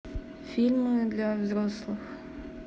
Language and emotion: Russian, neutral